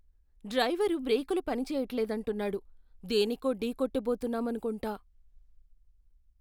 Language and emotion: Telugu, fearful